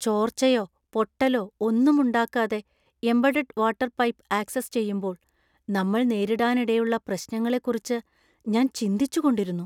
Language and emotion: Malayalam, fearful